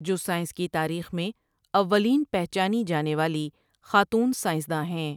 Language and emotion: Urdu, neutral